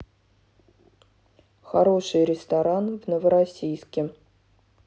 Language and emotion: Russian, neutral